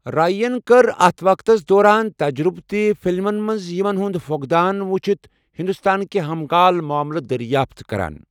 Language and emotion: Kashmiri, neutral